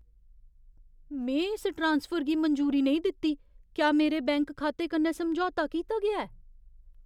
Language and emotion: Dogri, fearful